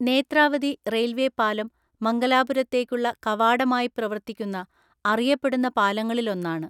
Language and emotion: Malayalam, neutral